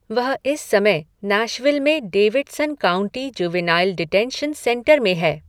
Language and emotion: Hindi, neutral